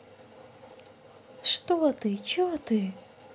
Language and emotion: Russian, neutral